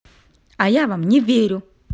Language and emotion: Russian, angry